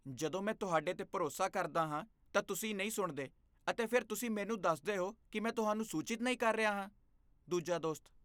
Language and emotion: Punjabi, disgusted